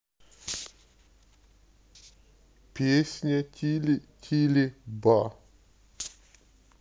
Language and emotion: Russian, sad